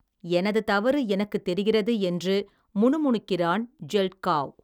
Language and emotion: Tamil, neutral